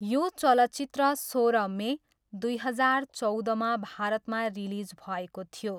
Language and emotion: Nepali, neutral